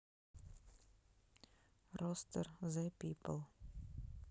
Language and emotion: Russian, neutral